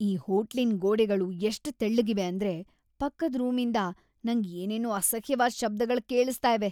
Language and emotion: Kannada, disgusted